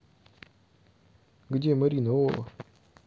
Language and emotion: Russian, neutral